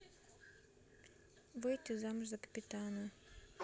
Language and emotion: Russian, neutral